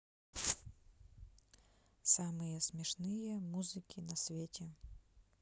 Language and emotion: Russian, neutral